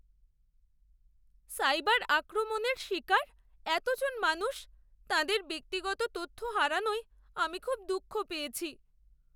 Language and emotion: Bengali, sad